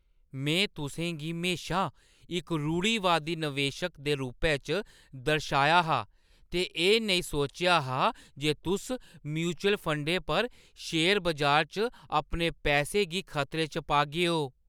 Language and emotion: Dogri, surprised